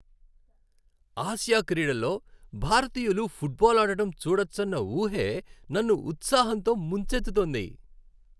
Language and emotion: Telugu, happy